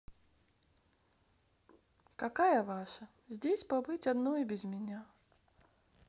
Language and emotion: Russian, sad